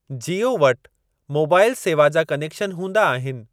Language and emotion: Sindhi, neutral